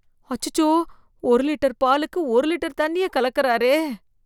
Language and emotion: Tamil, disgusted